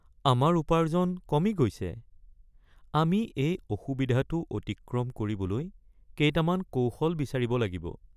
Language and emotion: Assamese, sad